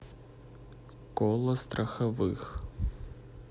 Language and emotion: Russian, neutral